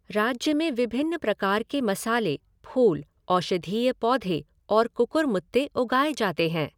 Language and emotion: Hindi, neutral